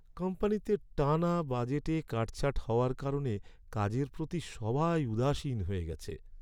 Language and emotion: Bengali, sad